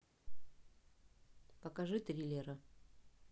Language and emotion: Russian, neutral